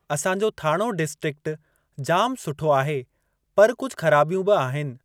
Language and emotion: Sindhi, neutral